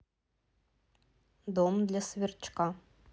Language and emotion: Russian, neutral